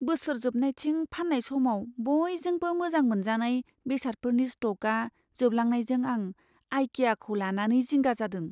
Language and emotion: Bodo, fearful